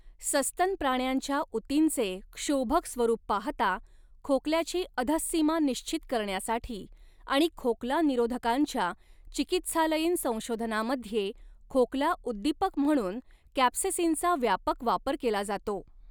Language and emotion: Marathi, neutral